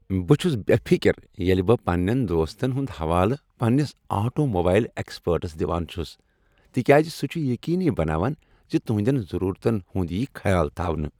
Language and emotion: Kashmiri, happy